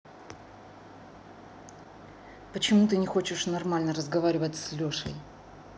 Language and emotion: Russian, angry